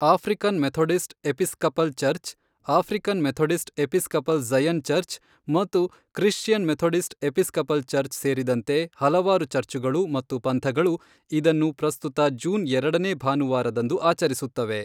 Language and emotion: Kannada, neutral